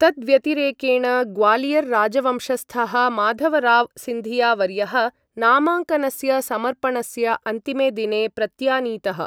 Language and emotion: Sanskrit, neutral